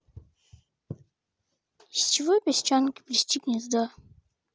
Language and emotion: Russian, neutral